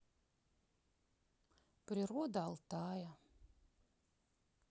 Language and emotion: Russian, sad